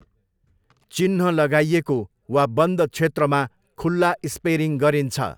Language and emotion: Nepali, neutral